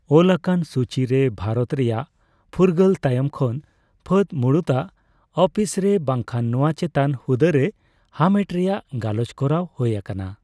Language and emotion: Santali, neutral